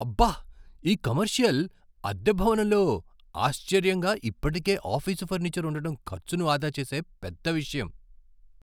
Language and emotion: Telugu, surprised